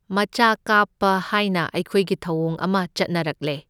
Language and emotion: Manipuri, neutral